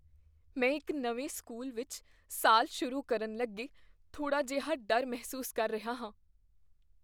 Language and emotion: Punjabi, fearful